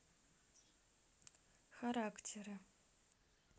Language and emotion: Russian, neutral